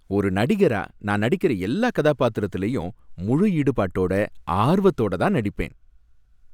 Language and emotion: Tamil, happy